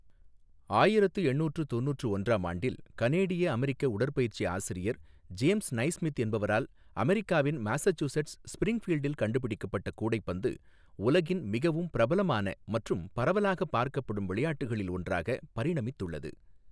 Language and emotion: Tamil, neutral